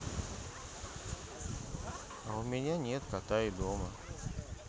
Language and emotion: Russian, sad